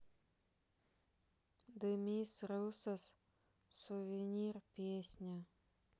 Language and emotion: Russian, sad